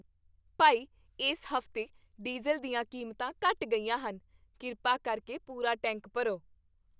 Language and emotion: Punjabi, happy